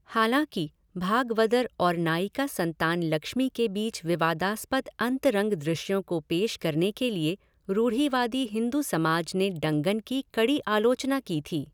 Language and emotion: Hindi, neutral